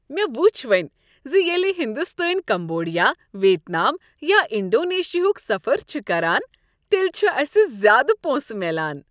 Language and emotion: Kashmiri, happy